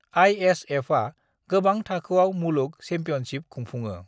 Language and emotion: Bodo, neutral